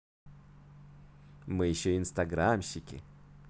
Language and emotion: Russian, positive